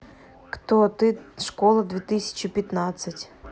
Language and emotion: Russian, neutral